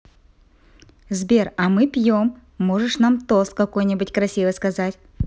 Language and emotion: Russian, positive